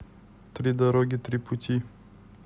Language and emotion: Russian, neutral